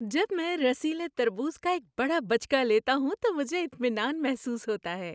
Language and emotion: Urdu, happy